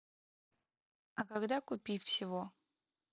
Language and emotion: Russian, neutral